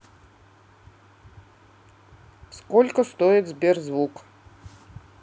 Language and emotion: Russian, neutral